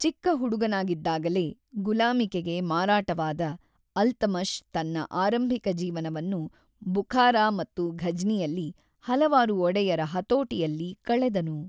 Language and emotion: Kannada, neutral